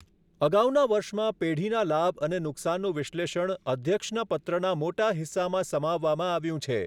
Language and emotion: Gujarati, neutral